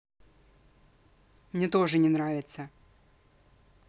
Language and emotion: Russian, angry